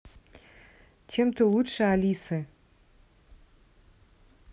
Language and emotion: Russian, neutral